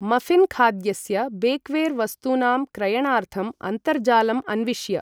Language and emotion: Sanskrit, neutral